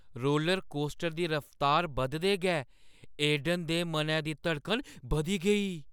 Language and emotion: Dogri, fearful